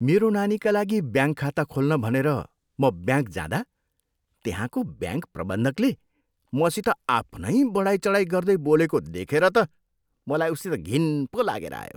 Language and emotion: Nepali, disgusted